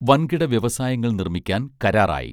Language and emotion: Malayalam, neutral